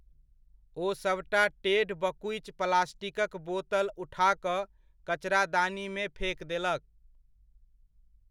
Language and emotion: Maithili, neutral